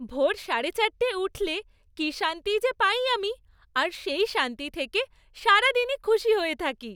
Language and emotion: Bengali, happy